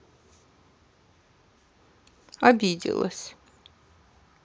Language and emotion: Russian, sad